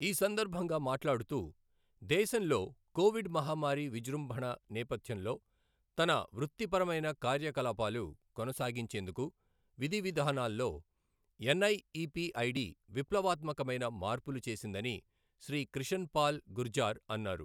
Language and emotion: Telugu, neutral